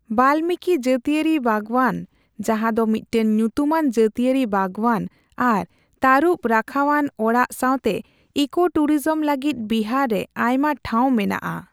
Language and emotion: Santali, neutral